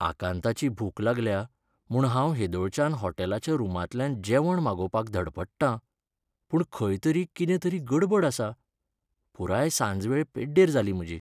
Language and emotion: Goan Konkani, sad